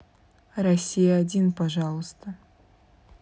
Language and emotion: Russian, neutral